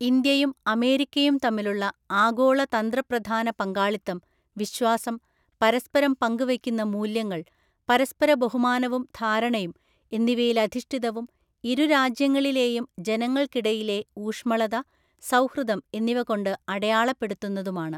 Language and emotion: Malayalam, neutral